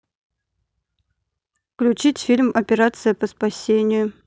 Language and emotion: Russian, neutral